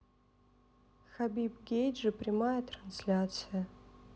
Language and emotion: Russian, sad